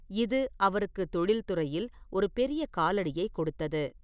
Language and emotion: Tamil, neutral